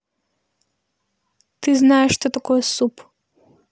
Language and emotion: Russian, neutral